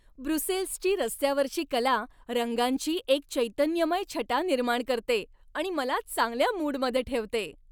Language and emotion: Marathi, happy